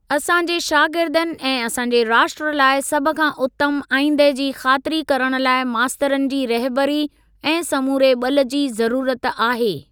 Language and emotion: Sindhi, neutral